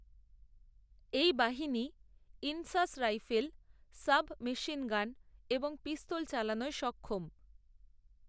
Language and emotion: Bengali, neutral